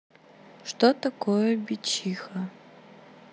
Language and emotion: Russian, neutral